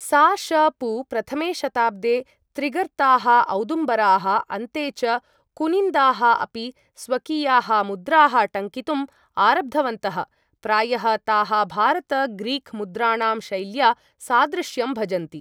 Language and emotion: Sanskrit, neutral